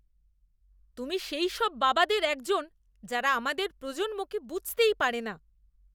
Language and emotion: Bengali, disgusted